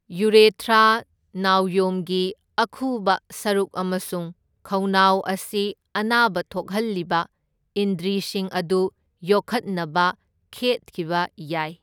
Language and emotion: Manipuri, neutral